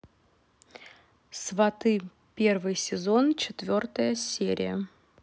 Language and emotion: Russian, neutral